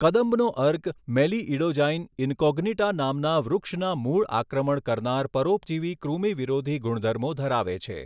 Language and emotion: Gujarati, neutral